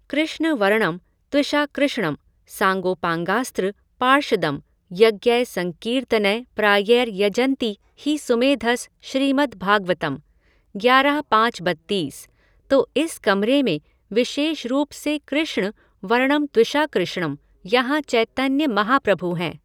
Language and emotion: Hindi, neutral